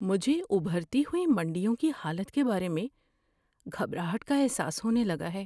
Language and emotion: Urdu, fearful